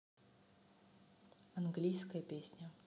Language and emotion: Russian, neutral